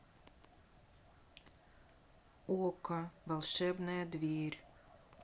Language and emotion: Russian, neutral